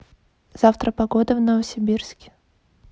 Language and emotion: Russian, neutral